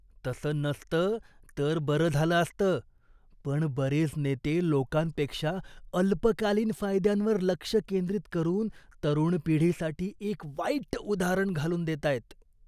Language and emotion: Marathi, disgusted